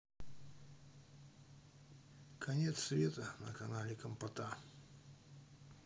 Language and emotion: Russian, neutral